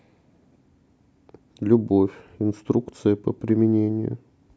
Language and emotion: Russian, sad